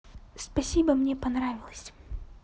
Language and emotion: Russian, positive